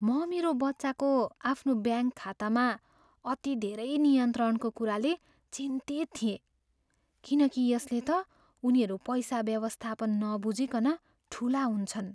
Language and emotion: Nepali, fearful